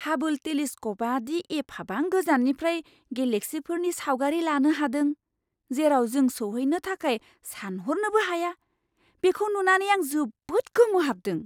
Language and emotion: Bodo, surprised